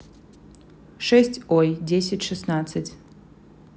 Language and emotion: Russian, neutral